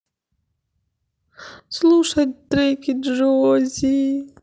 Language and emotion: Russian, sad